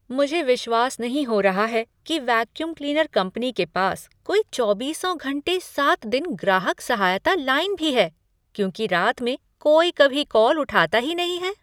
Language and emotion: Hindi, surprised